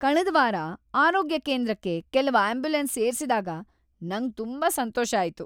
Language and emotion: Kannada, happy